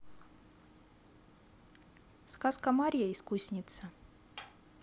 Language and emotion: Russian, neutral